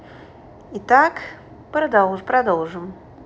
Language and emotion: Russian, neutral